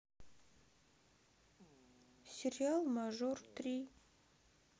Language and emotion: Russian, sad